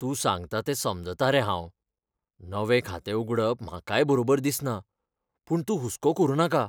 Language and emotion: Goan Konkani, fearful